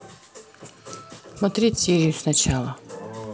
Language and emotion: Russian, neutral